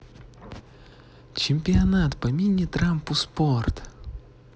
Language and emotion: Russian, positive